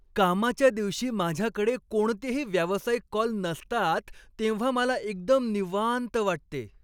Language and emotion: Marathi, happy